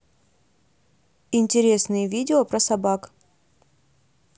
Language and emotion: Russian, neutral